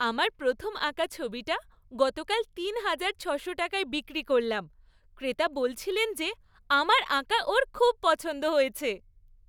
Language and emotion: Bengali, happy